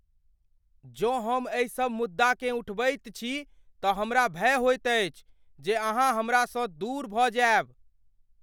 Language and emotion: Maithili, fearful